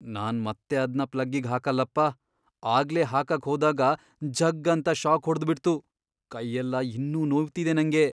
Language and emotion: Kannada, fearful